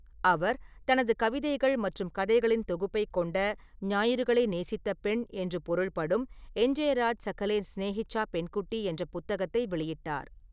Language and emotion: Tamil, neutral